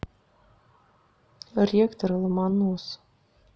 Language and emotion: Russian, neutral